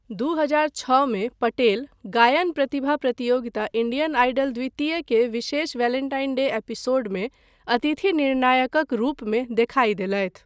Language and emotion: Maithili, neutral